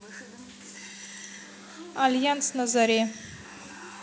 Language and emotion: Russian, neutral